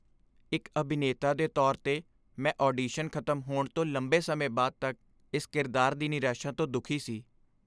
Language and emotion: Punjabi, sad